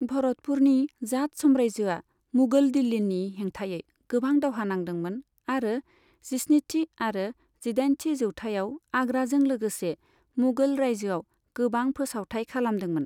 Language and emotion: Bodo, neutral